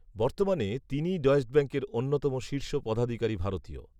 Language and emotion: Bengali, neutral